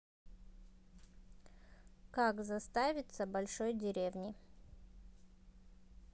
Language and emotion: Russian, neutral